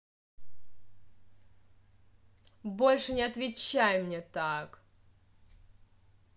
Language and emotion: Russian, angry